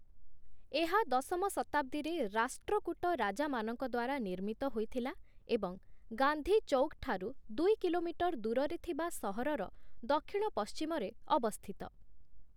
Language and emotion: Odia, neutral